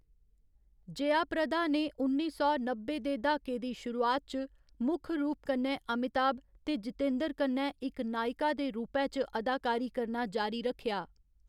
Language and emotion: Dogri, neutral